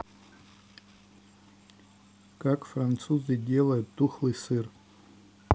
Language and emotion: Russian, neutral